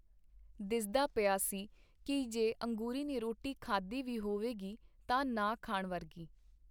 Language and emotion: Punjabi, neutral